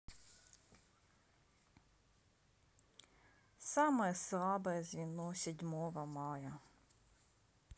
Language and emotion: Russian, sad